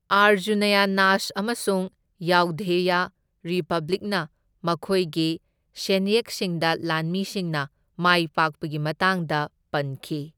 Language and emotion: Manipuri, neutral